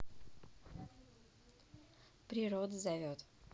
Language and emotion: Russian, neutral